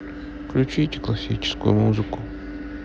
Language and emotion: Russian, sad